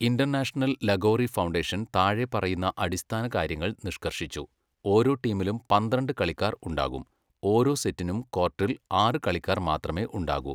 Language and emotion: Malayalam, neutral